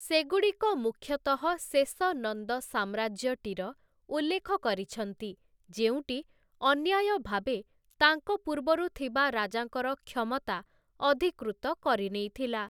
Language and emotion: Odia, neutral